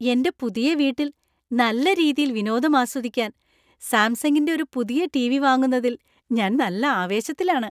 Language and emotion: Malayalam, happy